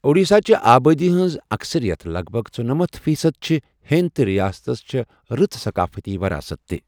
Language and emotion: Kashmiri, neutral